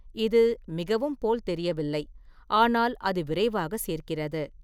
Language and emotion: Tamil, neutral